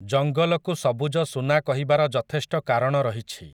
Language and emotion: Odia, neutral